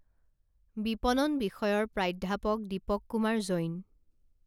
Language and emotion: Assamese, neutral